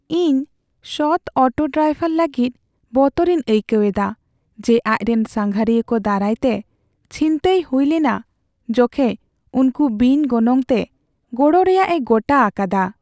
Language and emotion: Santali, sad